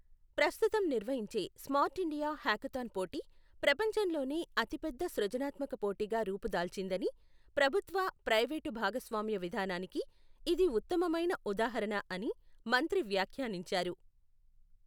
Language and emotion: Telugu, neutral